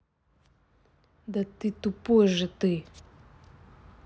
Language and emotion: Russian, angry